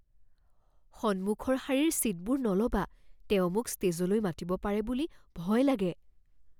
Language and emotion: Assamese, fearful